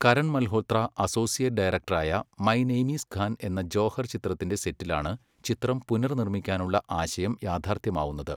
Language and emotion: Malayalam, neutral